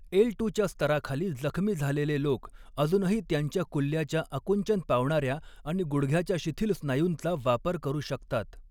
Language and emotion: Marathi, neutral